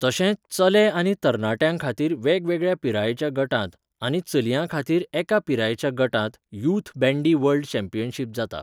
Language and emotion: Goan Konkani, neutral